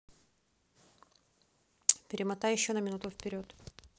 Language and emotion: Russian, neutral